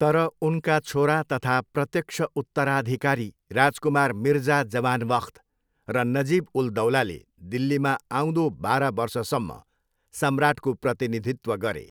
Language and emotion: Nepali, neutral